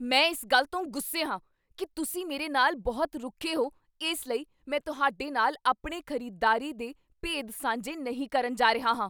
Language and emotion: Punjabi, angry